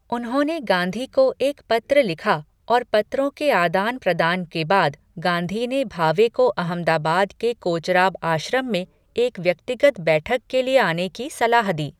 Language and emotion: Hindi, neutral